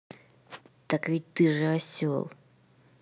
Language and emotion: Russian, angry